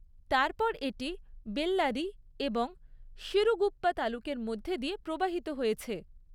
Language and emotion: Bengali, neutral